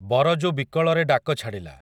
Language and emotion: Odia, neutral